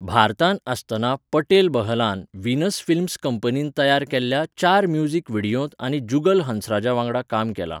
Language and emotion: Goan Konkani, neutral